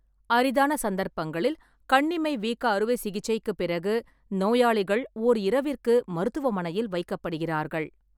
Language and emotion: Tamil, neutral